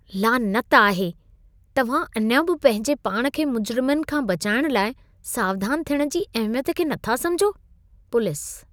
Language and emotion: Sindhi, disgusted